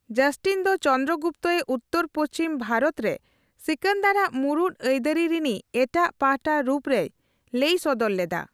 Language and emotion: Santali, neutral